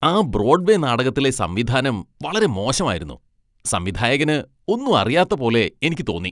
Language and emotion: Malayalam, disgusted